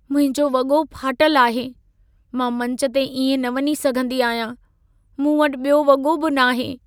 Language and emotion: Sindhi, sad